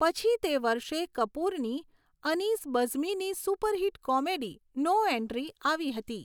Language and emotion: Gujarati, neutral